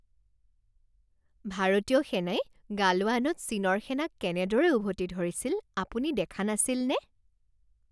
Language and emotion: Assamese, happy